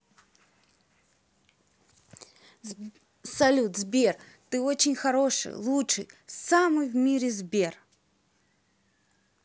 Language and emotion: Russian, positive